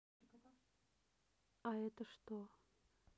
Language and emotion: Russian, neutral